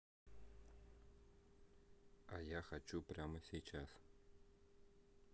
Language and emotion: Russian, neutral